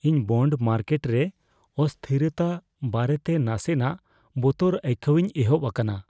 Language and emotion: Santali, fearful